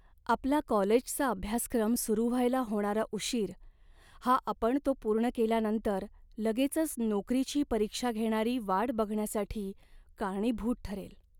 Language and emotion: Marathi, sad